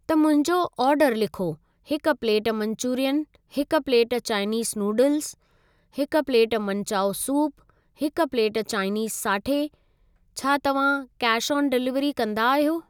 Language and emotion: Sindhi, neutral